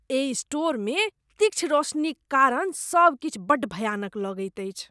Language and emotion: Maithili, disgusted